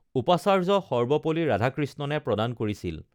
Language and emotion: Assamese, neutral